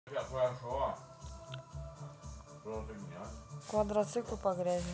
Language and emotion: Russian, neutral